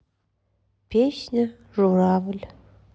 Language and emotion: Russian, sad